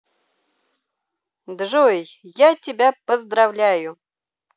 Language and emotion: Russian, positive